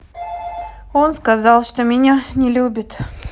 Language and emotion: Russian, sad